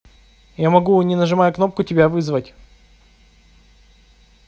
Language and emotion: Russian, neutral